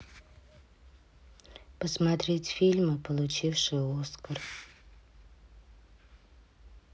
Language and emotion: Russian, neutral